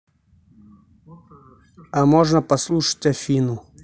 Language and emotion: Russian, neutral